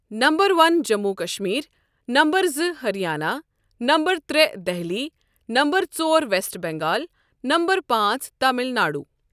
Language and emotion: Kashmiri, neutral